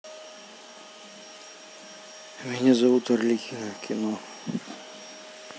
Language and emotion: Russian, sad